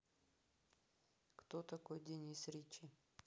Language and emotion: Russian, neutral